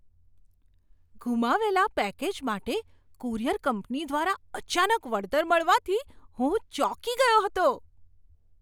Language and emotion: Gujarati, surprised